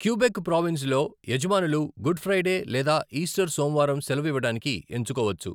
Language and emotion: Telugu, neutral